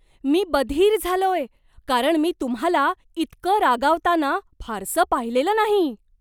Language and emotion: Marathi, surprised